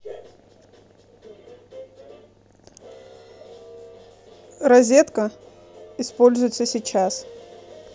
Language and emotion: Russian, neutral